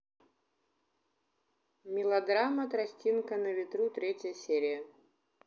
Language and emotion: Russian, neutral